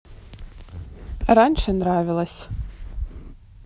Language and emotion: Russian, neutral